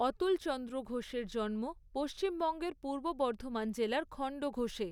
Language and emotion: Bengali, neutral